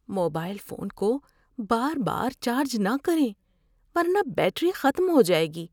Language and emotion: Urdu, fearful